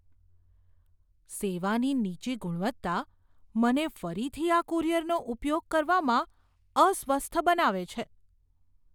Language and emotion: Gujarati, fearful